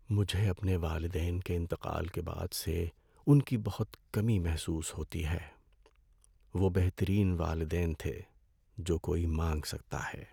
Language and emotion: Urdu, sad